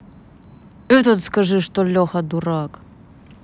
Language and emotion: Russian, angry